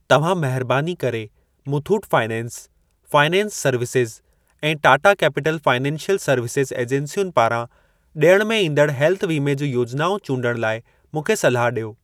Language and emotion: Sindhi, neutral